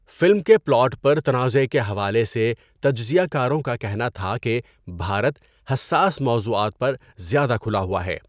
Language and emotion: Urdu, neutral